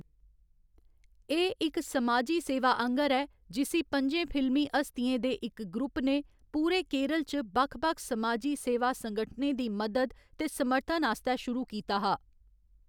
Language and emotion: Dogri, neutral